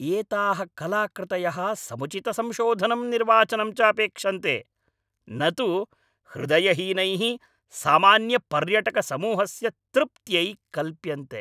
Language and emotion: Sanskrit, angry